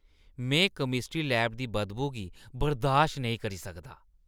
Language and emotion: Dogri, disgusted